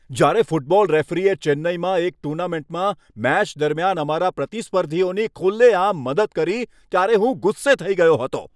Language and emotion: Gujarati, angry